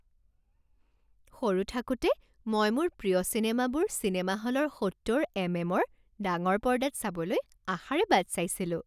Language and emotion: Assamese, happy